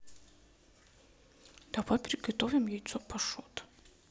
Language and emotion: Russian, neutral